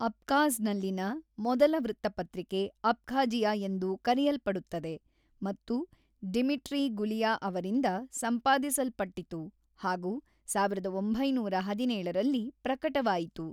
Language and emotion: Kannada, neutral